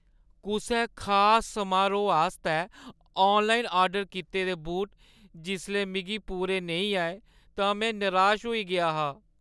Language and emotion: Dogri, sad